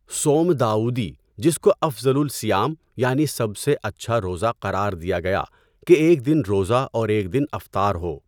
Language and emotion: Urdu, neutral